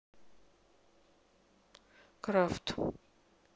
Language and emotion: Russian, neutral